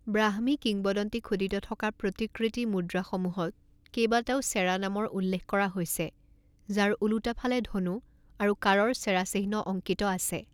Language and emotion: Assamese, neutral